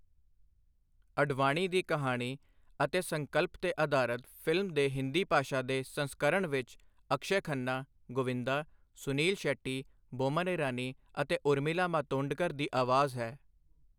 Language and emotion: Punjabi, neutral